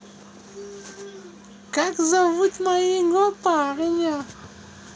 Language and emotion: Russian, neutral